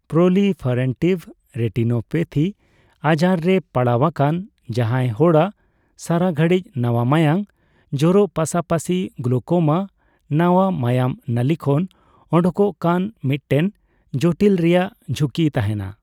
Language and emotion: Santali, neutral